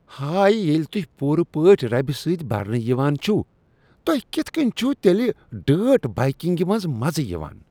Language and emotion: Kashmiri, disgusted